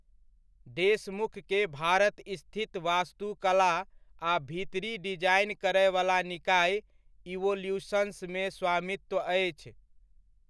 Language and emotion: Maithili, neutral